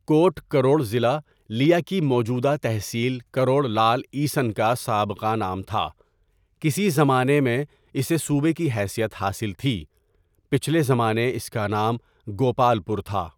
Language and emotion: Urdu, neutral